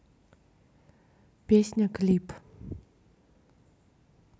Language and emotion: Russian, neutral